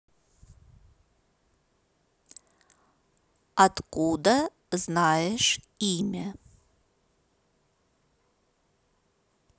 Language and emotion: Russian, neutral